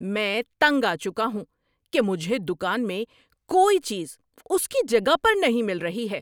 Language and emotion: Urdu, angry